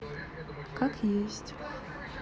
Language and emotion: Russian, sad